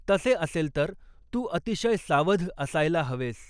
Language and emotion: Marathi, neutral